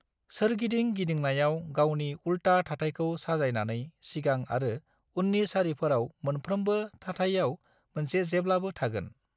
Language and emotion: Bodo, neutral